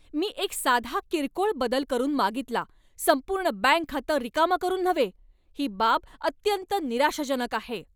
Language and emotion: Marathi, angry